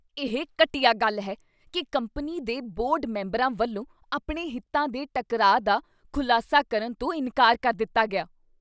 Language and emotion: Punjabi, disgusted